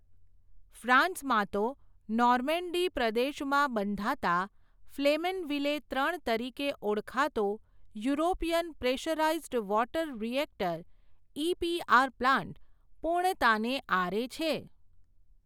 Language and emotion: Gujarati, neutral